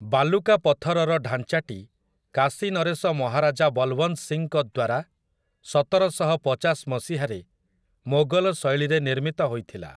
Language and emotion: Odia, neutral